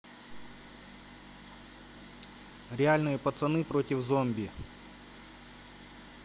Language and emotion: Russian, neutral